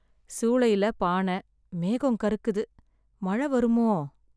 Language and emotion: Tamil, sad